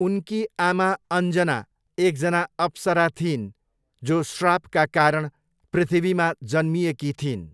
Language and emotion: Nepali, neutral